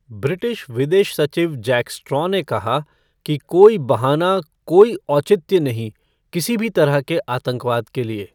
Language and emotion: Hindi, neutral